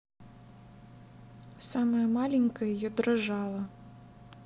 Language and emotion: Russian, neutral